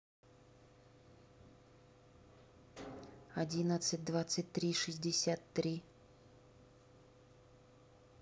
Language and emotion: Russian, neutral